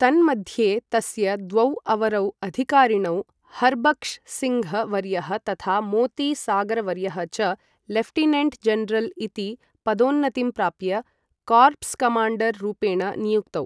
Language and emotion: Sanskrit, neutral